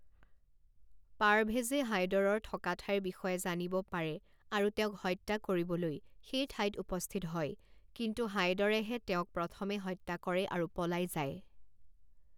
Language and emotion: Assamese, neutral